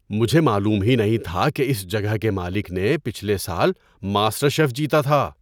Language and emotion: Urdu, surprised